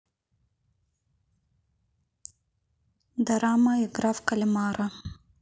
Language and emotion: Russian, neutral